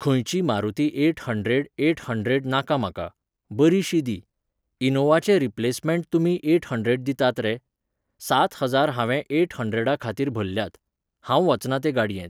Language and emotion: Goan Konkani, neutral